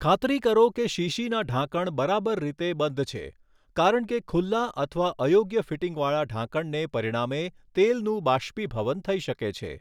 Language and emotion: Gujarati, neutral